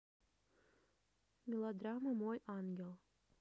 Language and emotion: Russian, neutral